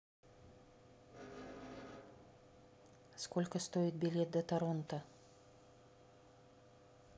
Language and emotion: Russian, neutral